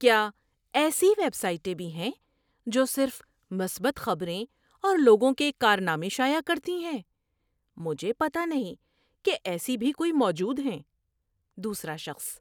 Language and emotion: Urdu, surprised